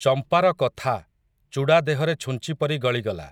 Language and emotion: Odia, neutral